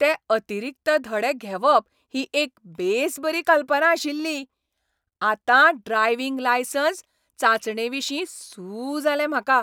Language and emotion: Goan Konkani, happy